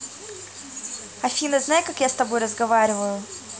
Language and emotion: Russian, neutral